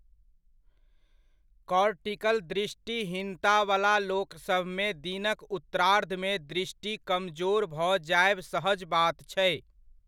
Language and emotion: Maithili, neutral